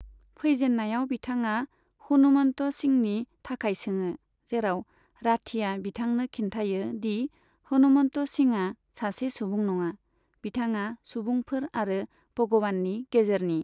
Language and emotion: Bodo, neutral